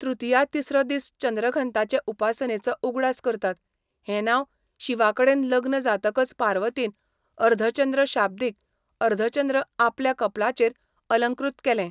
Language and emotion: Goan Konkani, neutral